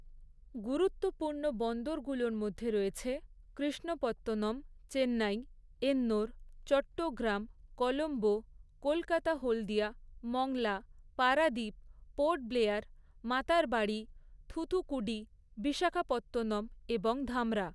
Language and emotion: Bengali, neutral